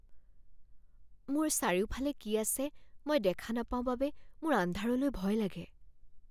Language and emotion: Assamese, fearful